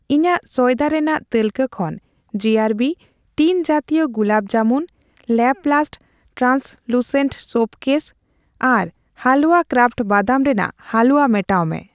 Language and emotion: Santali, neutral